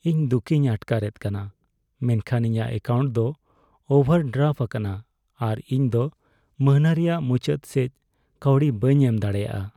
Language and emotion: Santali, sad